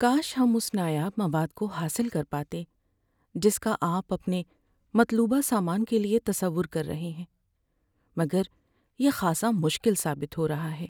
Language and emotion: Urdu, sad